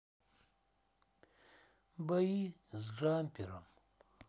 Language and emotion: Russian, sad